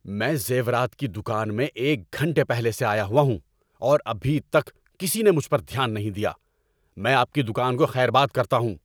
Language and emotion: Urdu, angry